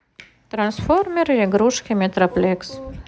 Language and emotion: Russian, neutral